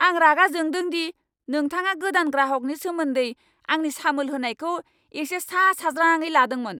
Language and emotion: Bodo, angry